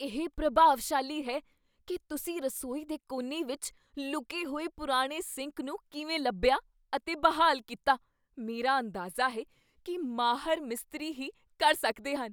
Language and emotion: Punjabi, surprised